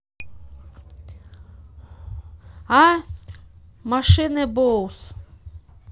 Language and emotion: Russian, neutral